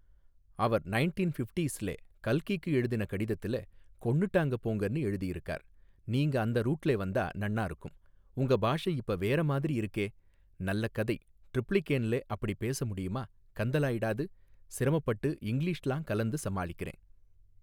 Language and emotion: Tamil, neutral